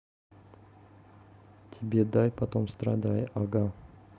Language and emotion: Russian, neutral